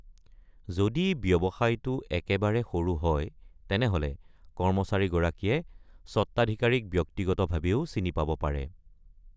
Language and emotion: Assamese, neutral